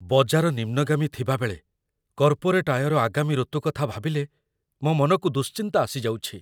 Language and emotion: Odia, fearful